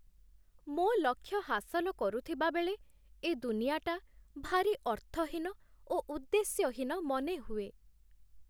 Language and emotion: Odia, sad